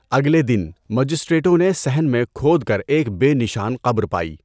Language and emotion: Urdu, neutral